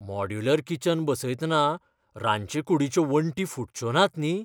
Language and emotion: Goan Konkani, fearful